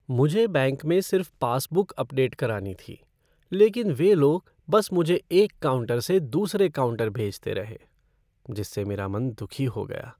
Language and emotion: Hindi, sad